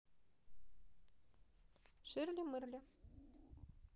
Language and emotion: Russian, neutral